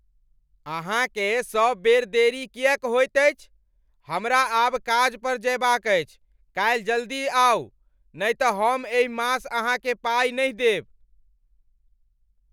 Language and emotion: Maithili, angry